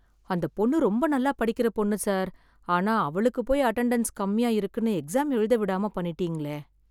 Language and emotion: Tamil, sad